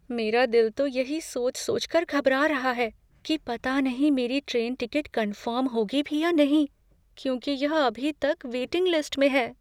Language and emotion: Hindi, fearful